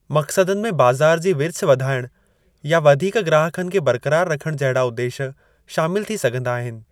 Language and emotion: Sindhi, neutral